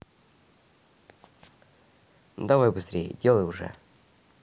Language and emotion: Russian, neutral